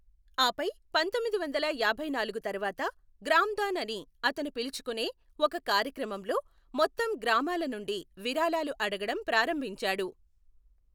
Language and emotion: Telugu, neutral